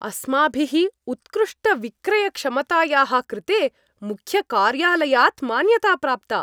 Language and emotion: Sanskrit, happy